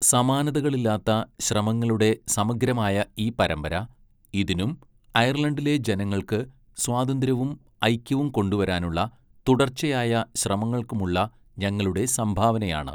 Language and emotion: Malayalam, neutral